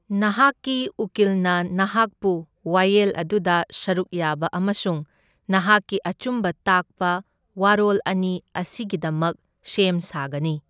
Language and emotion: Manipuri, neutral